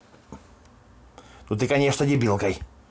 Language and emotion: Russian, angry